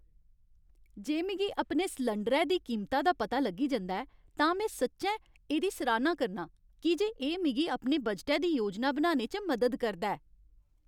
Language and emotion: Dogri, happy